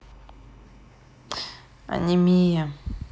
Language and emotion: Russian, sad